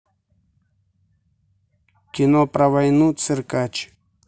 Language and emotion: Russian, neutral